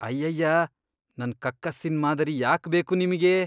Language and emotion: Kannada, disgusted